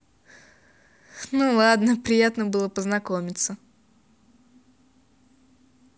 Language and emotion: Russian, positive